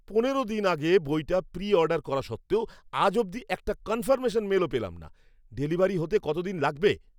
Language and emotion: Bengali, angry